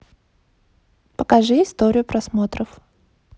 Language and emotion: Russian, neutral